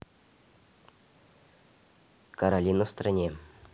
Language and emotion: Russian, neutral